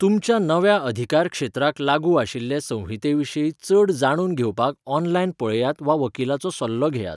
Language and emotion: Goan Konkani, neutral